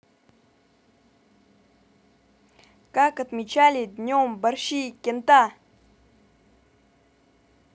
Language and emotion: Russian, positive